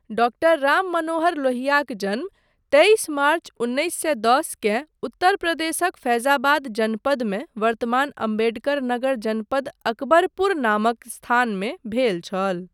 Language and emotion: Maithili, neutral